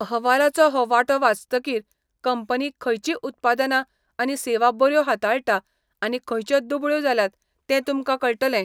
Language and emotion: Goan Konkani, neutral